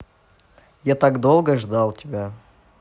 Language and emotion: Russian, positive